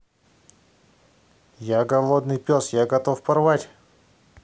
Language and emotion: Russian, neutral